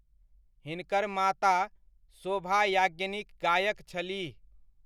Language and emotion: Maithili, neutral